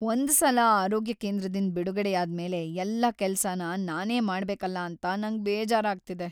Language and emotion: Kannada, sad